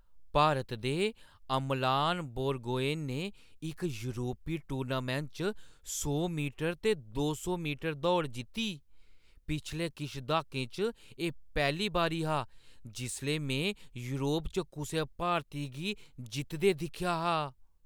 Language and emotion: Dogri, surprised